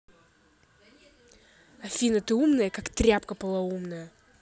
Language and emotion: Russian, angry